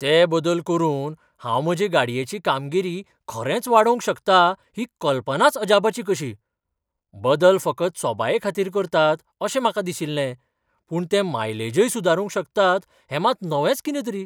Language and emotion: Goan Konkani, surprised